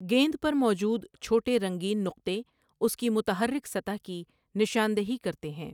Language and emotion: Urdu, neutral